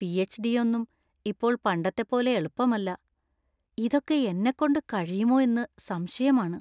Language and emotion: Malayalam, fearful